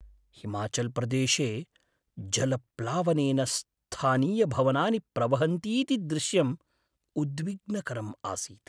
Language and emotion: Sanskrit, sad